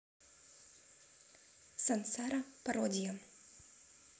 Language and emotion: Russian, neutral